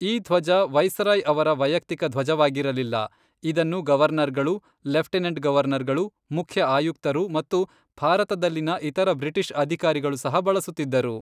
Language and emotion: Kannada, neutral